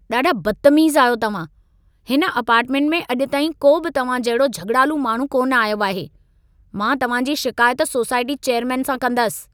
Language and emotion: Sindhi, angry